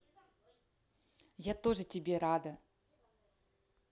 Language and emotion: Russian, positive